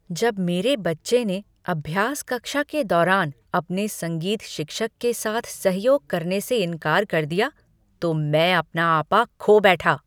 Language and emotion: Hindi, angry